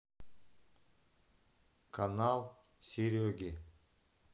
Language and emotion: Russian, neutral